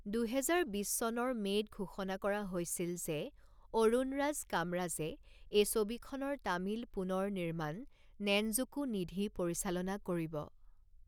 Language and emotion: Assamese, neutral